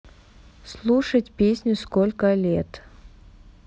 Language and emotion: Russian, neutral